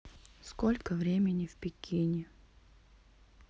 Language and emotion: Russian, sad